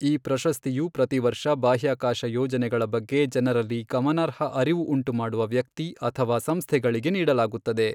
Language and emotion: Kannada, neutral